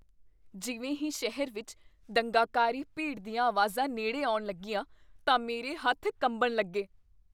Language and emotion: Punjabi, fearful